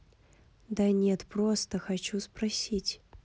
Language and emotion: Russian, angry